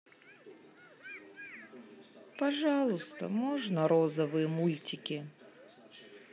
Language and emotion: Russian, sad